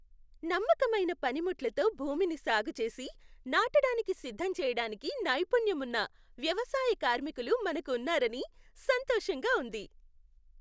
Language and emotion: Telugu, happy